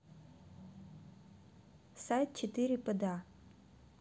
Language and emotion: Russian, neutral